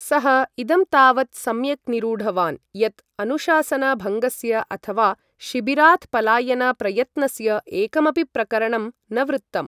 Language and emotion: Sanskrit, neutral